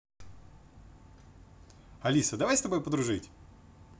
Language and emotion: Russian, positive